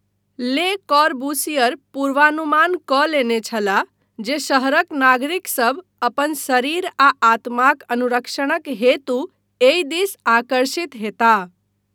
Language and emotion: Maithili, neutral